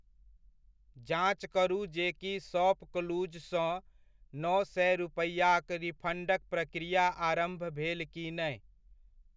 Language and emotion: Maithili, neutral